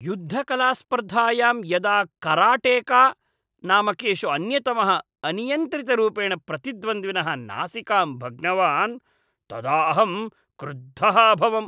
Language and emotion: Sanskrit, disgusted